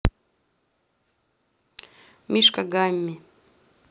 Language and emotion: Russian, neutral